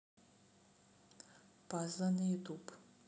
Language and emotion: Russian, neutral